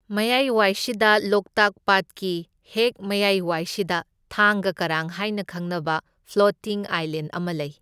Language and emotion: Manipuri, neutral